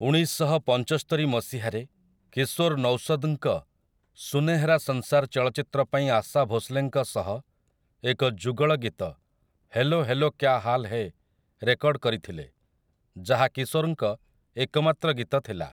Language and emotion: Odia, neutral